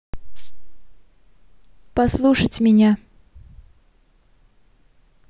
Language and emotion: Russian, neutral